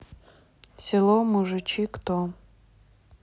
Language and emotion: Russian, neutral